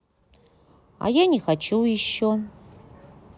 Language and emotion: Russian, neutral